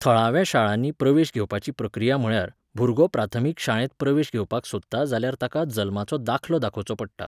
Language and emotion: Goan Konkani, neutral